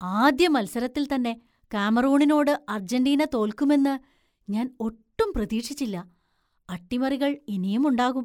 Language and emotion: Malayalam, surprised